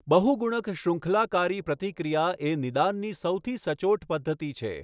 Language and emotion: Gujarati, neutral